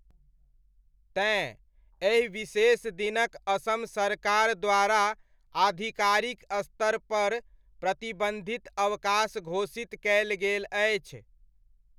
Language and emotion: Maithili, neutral